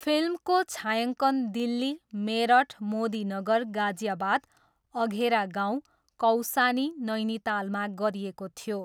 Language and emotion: Nepali, neutral